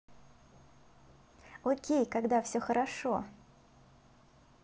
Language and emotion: Russian, positive